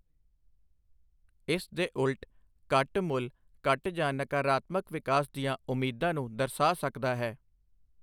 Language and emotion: Punjabi, neutral